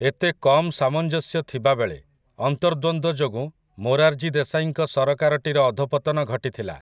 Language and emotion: Odia, neutral